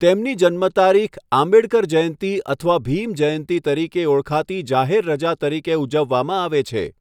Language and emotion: Gujarati, neutral